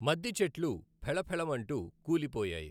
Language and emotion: Telugu, neutral